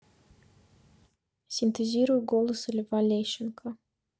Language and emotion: Russian, neutral